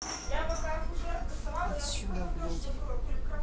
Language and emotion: Russian, neutral